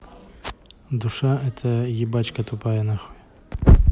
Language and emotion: Russian, neutral